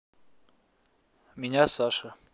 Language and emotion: Russian, neutral